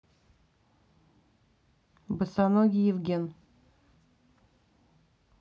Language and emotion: Russian, neutral